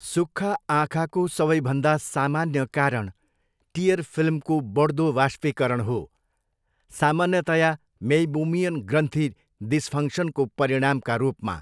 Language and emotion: Nepali, neutral